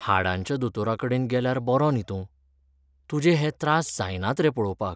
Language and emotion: Goan Konkani, sad